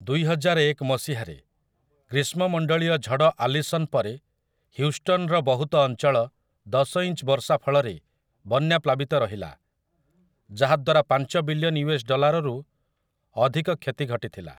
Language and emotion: Odia, neutral